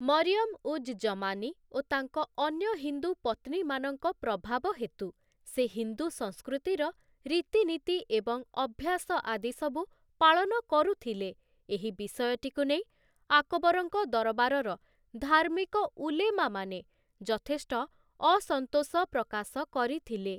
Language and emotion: Odia, neutral